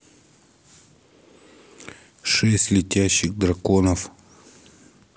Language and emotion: Russian, neutral